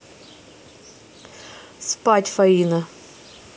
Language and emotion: Russian, neutral